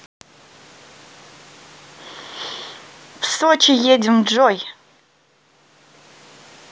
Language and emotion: Russian, positive